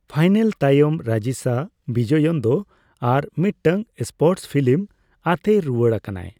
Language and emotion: Santali, neutral